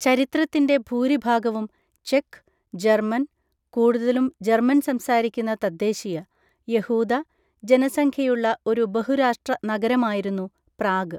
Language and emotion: Malayalam, neutral